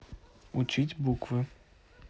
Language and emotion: Russian, neutral